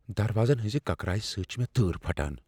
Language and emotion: Kashmiri, fearful